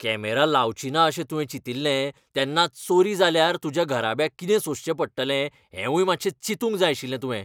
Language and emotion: Goan Konkani, angry